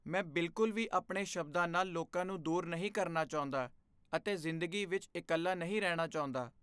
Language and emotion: Punjabi, fearful